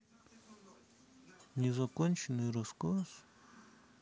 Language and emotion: Russian, sad